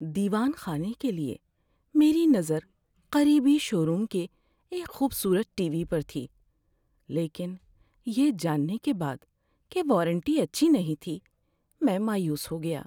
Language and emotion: Urdu, sad